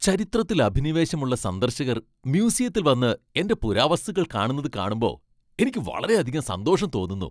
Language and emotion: Malayalam, happy